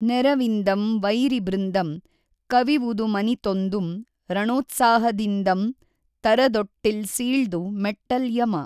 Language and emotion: Kannada, neutral